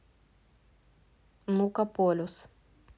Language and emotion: Russian, neutral